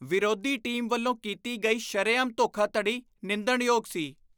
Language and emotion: Punjabi, disgusted